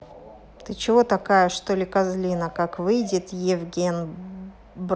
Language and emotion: Russian, angry